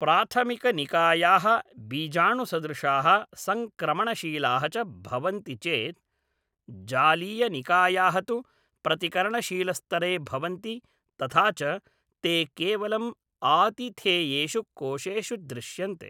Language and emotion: Sanskrit, neutral